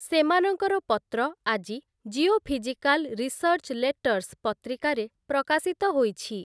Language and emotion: Odia, neutral